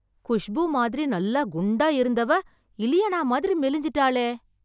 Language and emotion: Tamil, surprised